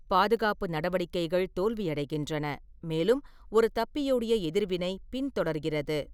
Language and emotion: Tamil, neutral